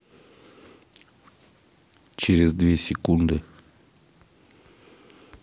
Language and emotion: Russian, neutral